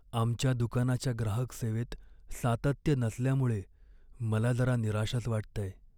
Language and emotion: Marathi, sad